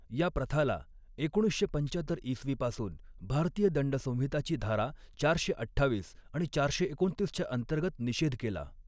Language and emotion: Marathi, neutral